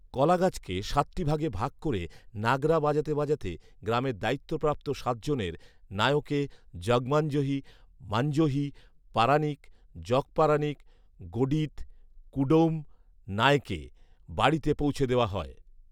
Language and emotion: Bengali, neutral